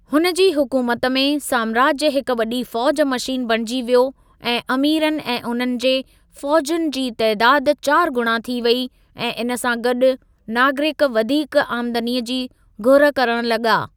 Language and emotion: Sindhi, neutral